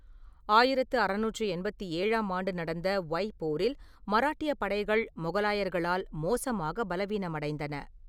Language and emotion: Tamil, neutral